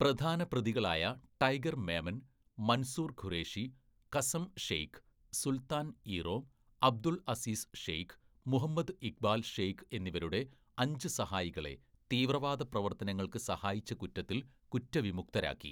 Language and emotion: Malayalam, neutral